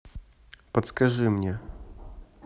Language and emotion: Russian, neutral